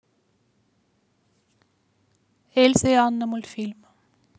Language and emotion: Russian, neutral